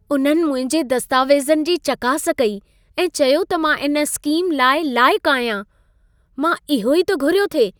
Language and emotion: Sindhi, happy